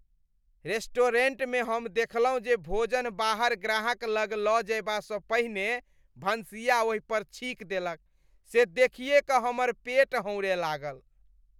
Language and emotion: Maithili, disgusted